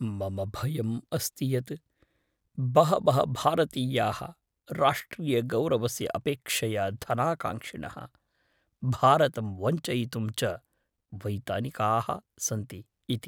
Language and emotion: Sanskrit, fearful